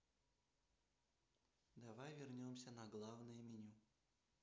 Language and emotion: Russian, neutral